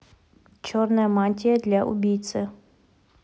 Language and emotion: Russian, neutral